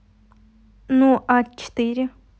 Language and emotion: Russian, neutral